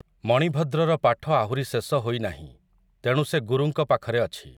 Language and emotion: Odia, neutral